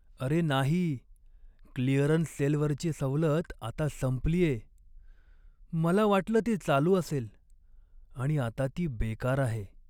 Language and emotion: Marathi, sad